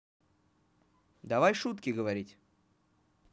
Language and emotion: Russian, positive